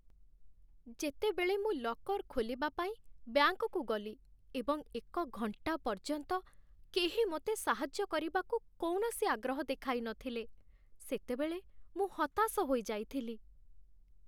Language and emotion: Odia, sad